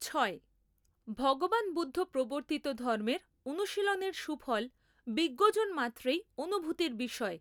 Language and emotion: Bengali, neutral